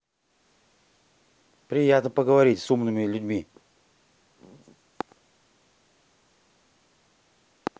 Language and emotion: Russian, neutral